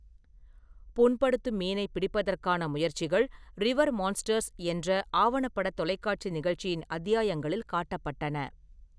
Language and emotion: Tamil, neutral